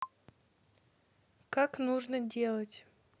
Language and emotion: Russian, neutral